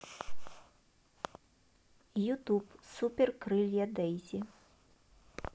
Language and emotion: Russian, neutral